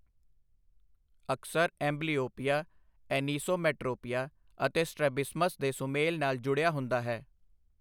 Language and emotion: Punjabi, neutral